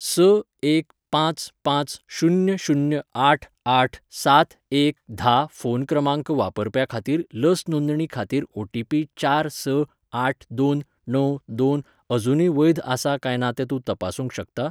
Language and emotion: Goan Konkani, neutral